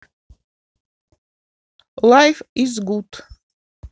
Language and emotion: Russian, neutral